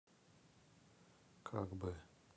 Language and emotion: Russian, neutral